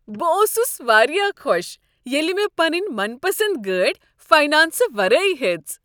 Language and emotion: Kashmiri, happy